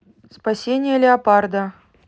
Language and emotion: Russian, neutral